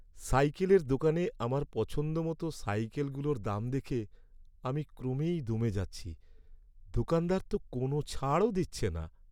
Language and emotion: Bengali, sad